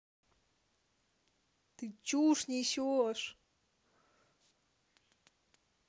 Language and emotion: Russian, angry